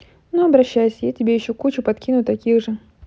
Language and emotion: Russian, neutral